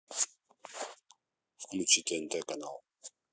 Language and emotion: Russian, neutral